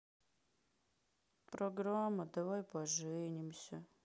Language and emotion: Russian, sad